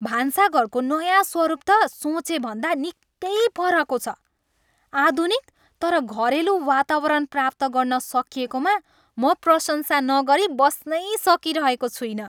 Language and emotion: Nepali, happy